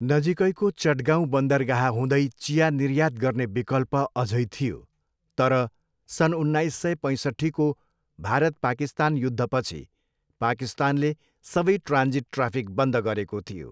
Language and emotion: Nepali, neutral